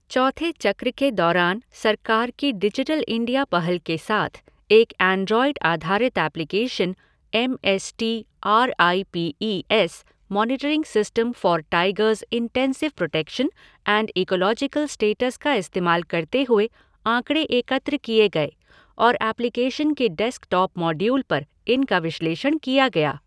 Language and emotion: Hindi, neutral